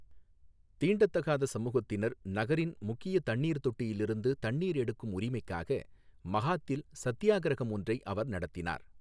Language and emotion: Tamil, neutral